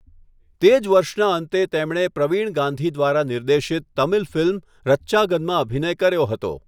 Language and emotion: Gujarati, neutral